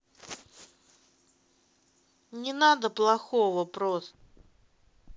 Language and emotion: Russian, neutral